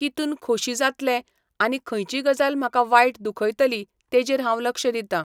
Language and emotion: Goan Konkani, neutral